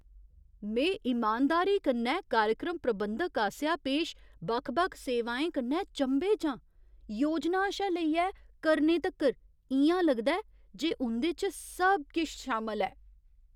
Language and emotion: Dogri, surprised